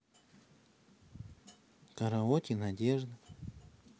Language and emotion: Russian, neutral